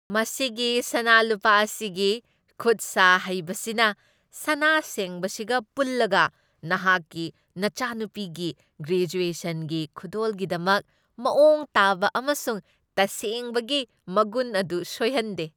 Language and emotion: Manipuri, happy